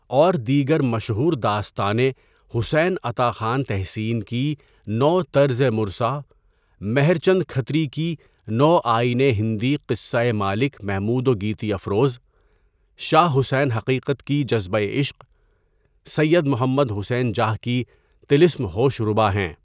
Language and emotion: Urdu, neutral